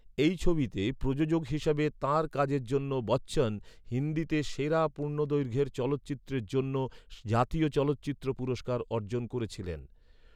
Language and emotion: Bengali, neutral